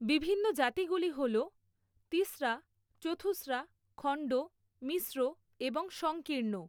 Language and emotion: Bengali, neutral